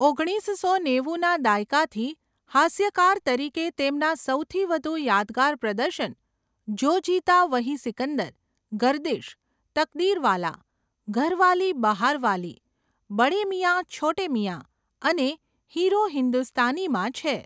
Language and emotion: Gujarati, neutral